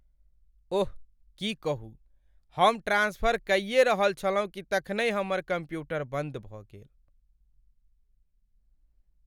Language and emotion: Maithili, sad